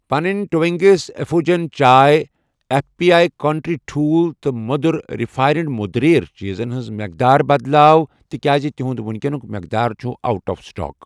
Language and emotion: Kashmiri, neutral